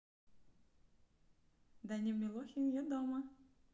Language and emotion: Russian, neutral